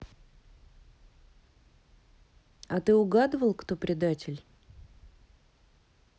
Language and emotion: Russian, neutral